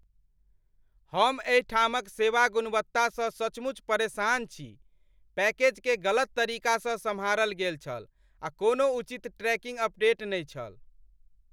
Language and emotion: Maithili, angry